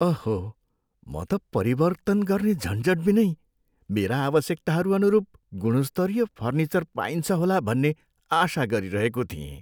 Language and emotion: Nepali, sad